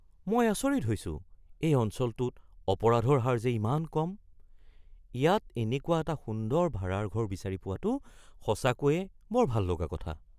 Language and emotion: Assamese, surprised